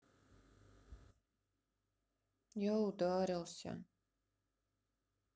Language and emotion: Russian, sad